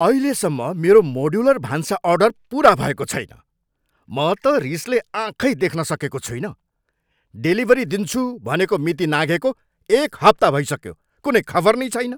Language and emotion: Nepali, angry